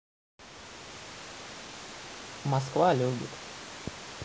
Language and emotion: Russian, neutral